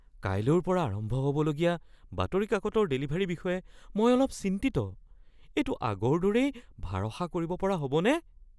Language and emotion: Assamese, fearful